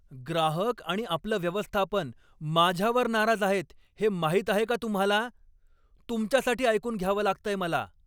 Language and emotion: Marathi, angry